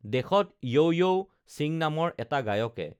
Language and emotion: Assamese, neutral